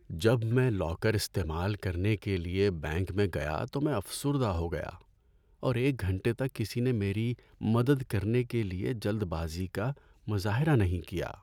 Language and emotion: Urdu, sad